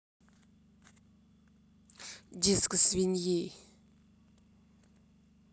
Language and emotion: Russian, angry